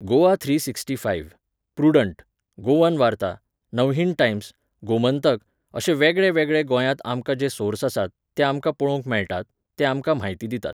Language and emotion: Goan Konkani, neutral